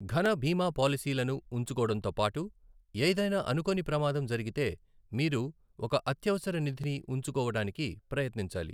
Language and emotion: Telugu, neutral